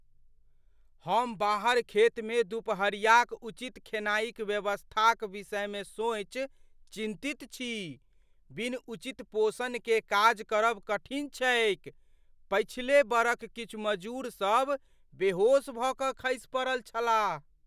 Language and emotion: Maithili, fearful